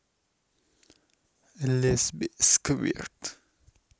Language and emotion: Russian, neutral